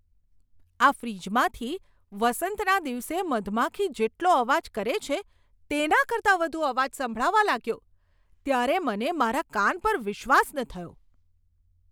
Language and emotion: Gujarati, surprised